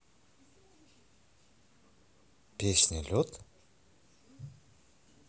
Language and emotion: Russian, neutral